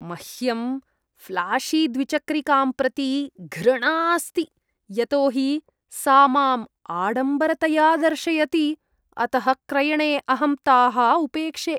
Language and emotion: Sanskrit, disgusted